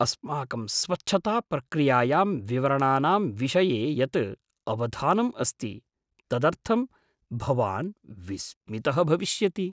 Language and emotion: Sanskrit, surprised